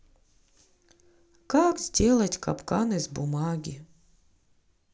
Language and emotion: Russian, sad